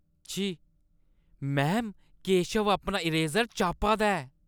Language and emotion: Dogri, disgusted